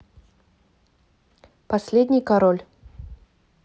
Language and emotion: Russian, neutral